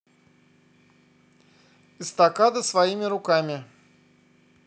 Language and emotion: Russian, neutral